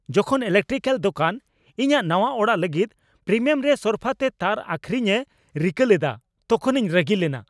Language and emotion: Santali, angry